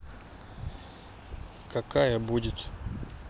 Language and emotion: Russian, neutral